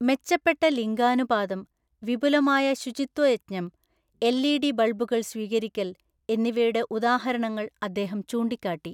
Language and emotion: Malayalam, neutral